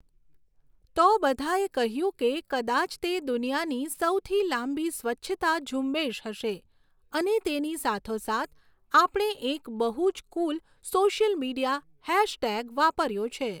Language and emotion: Gujarati, neutral